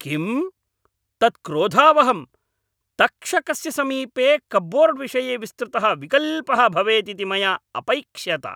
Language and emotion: Sanskrit, angry